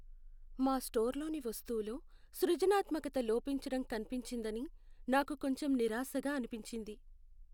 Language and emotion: Telugu, sad